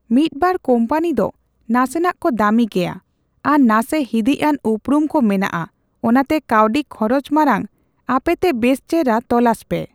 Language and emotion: Santali, neutral